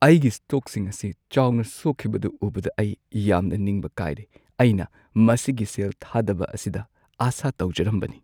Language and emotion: Manipuri, sad